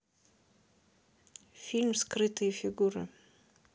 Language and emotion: Russian, neutral